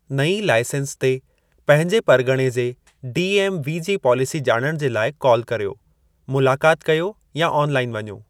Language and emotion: Sindhi, neutral